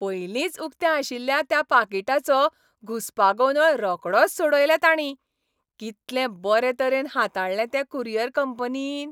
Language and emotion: Goan Konkani, happy